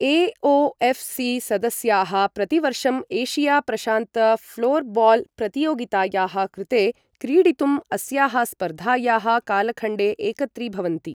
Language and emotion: Sanskrit, neutral